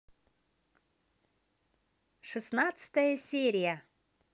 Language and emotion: Russian, positive